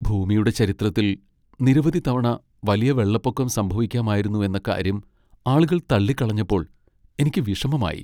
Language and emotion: Malayalam, sad